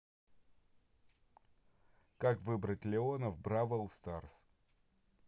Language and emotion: Russian, neutral